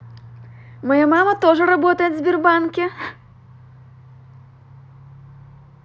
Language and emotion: Russian, positive